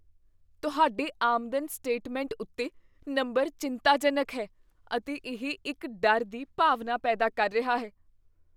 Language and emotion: Punjabi, fearful